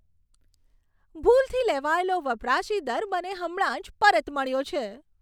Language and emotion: Gujarati, happy